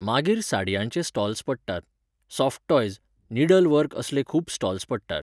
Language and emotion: Goan Konkani, neutral